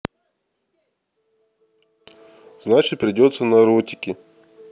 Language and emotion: Russian, neutral